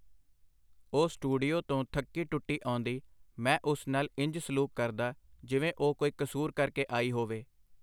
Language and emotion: Punjabi, neutral